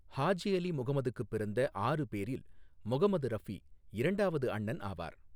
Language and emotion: Tamil, neutral